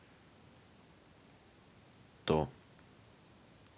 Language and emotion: Russian, neutral